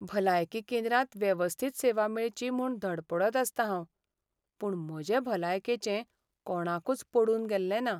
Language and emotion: Goan Konkani, sad